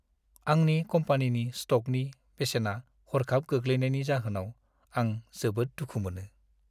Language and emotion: Bodo, sad